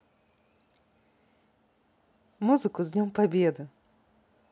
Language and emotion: Russian, positive